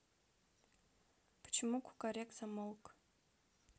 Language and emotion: Russian, neutral